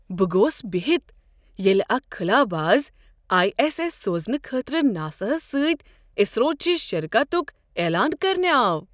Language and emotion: Kashmiri, surprised